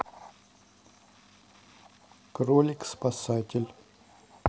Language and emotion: Russian, neutral